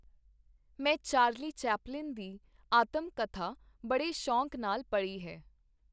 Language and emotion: Punjabi, neutral